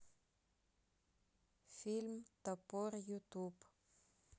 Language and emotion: Russian, neutral